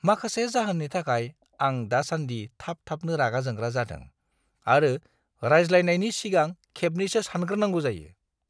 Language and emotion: Bodo, disgusted